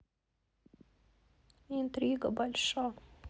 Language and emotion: Russian, sad